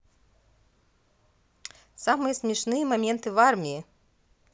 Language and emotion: Russian, positive